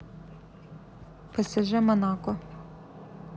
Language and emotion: Russian, neutral